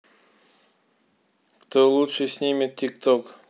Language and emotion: Russian, neutral